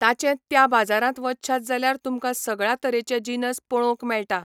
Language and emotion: Goan Konkani, neutral